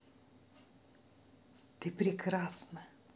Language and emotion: Russian, positive